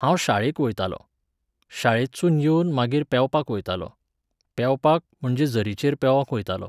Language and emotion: Goan Konkani, neutral